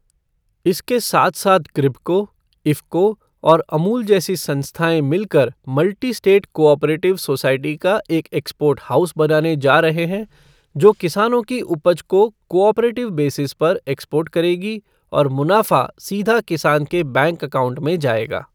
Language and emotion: Hindi, neutral